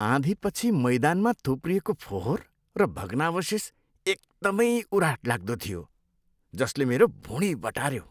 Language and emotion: Nepali, disgusted